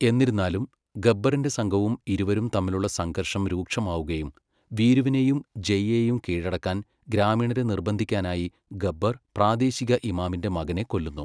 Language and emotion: Malayalam, neutral